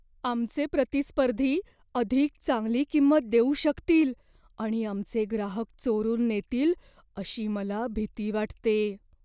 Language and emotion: Marathi, fearful